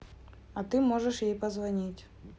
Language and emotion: Russian, neutral